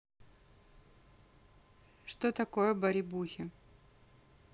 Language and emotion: Russian, neutral